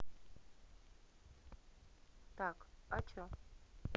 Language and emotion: Russian, neutral